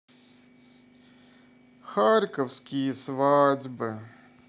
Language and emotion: Russian, sad